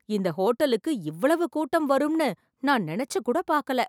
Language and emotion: Tamil, surprised